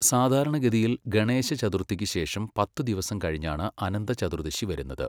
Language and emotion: Malayalam, neutral